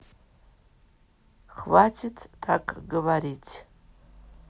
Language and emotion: Russian, neutral